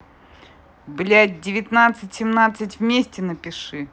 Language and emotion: Russian, angry